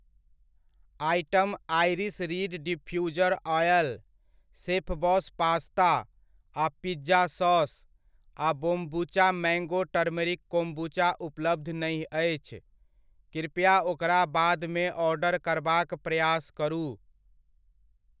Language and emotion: Maithili, neutral